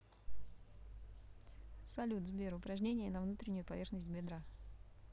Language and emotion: Russian, neutral